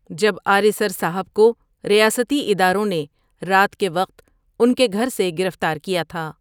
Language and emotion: Urdu, neutral